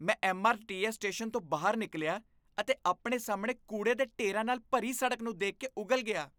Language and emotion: Punjabi, disgusted